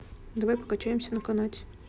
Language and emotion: Russian, neutral